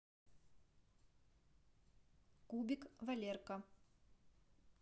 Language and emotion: Russian, neutral